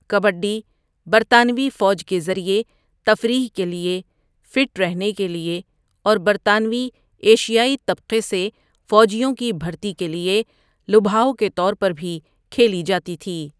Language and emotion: Urdu, neutral